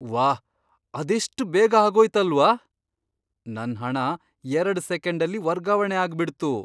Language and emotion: Kannada, surprised